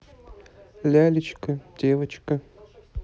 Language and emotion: Russian, neutral